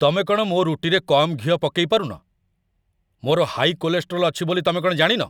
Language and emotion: Odia, angry